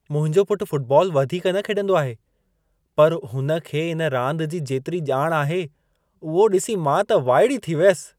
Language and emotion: Sindhi, surprised